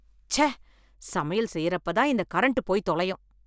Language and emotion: Tamil, angry